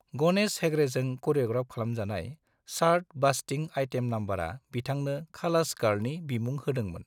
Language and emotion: Bodo, neutral